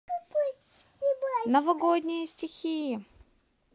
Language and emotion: Russian, positive